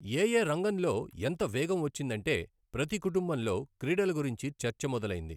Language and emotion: Telugu, neutral